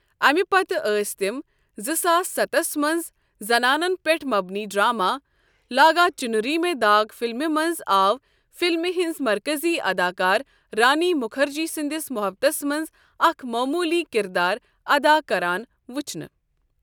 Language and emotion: Kashmiri, neutral